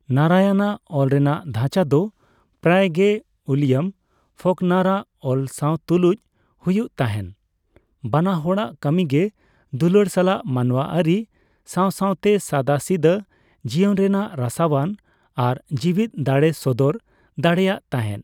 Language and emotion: Santali, neutral